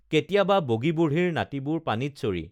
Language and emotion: Assamese, neutral